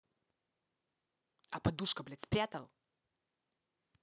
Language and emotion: Russian, angry